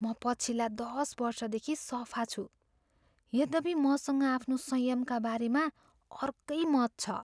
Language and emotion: Nepali, fearful